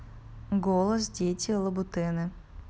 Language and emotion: Russian, neutral